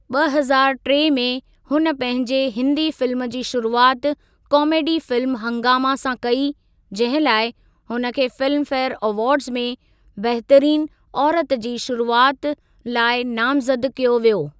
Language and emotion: Sindhi, neutral